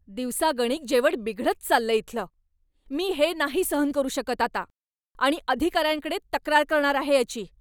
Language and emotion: Marathi, angry